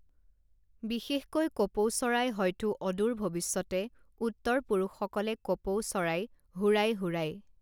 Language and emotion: Assamese, neutral